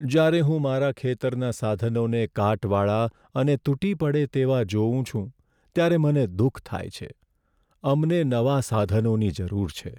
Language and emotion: Gujarati, sad